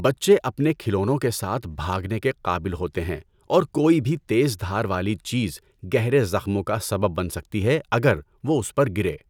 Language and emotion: Urdu, neutral